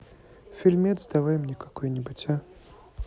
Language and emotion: Russian, neutral